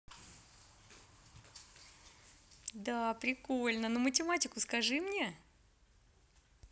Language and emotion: Russian, positive